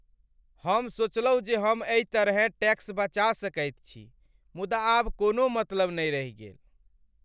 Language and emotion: Maithili, sad